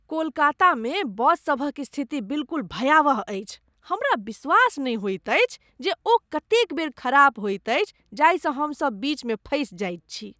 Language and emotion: Maithili, disgusted